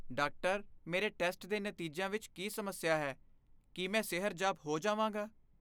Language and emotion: Punjabi, fearful